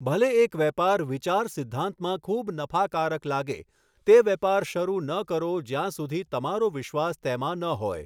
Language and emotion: Gujarati, neutral